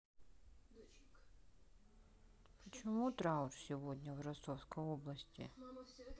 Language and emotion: Russian, sad